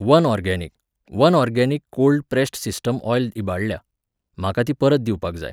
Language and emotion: Goan Konkani, neutral